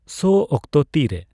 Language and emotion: Santali, neutral